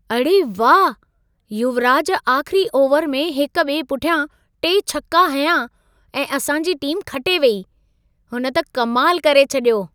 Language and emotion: Sindhi, surprised